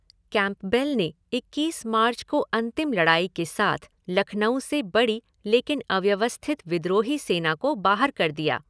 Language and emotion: Hindi, neutral